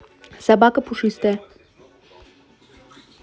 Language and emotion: Russian, neutral